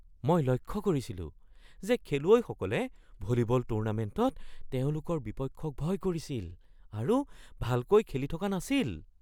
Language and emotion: Assamese, fearful